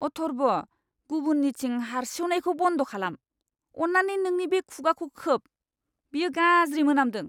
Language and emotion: Bodo, disgusted